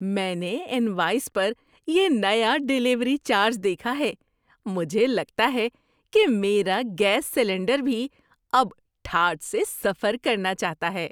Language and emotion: Urdu, surprised